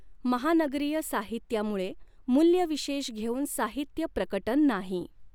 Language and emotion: Marathi, neutral